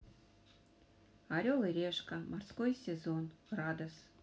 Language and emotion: Russian, neutral